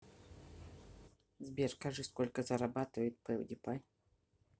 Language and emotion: Russian, neutral